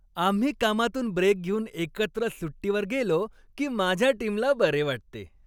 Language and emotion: Marathi, happy